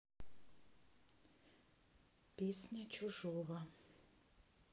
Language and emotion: Russian, neutral